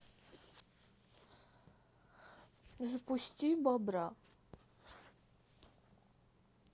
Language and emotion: Russian, neutral